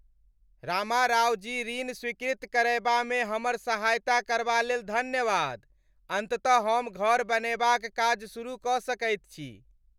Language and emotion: Maithili, happy